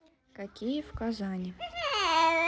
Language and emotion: Russian, neutral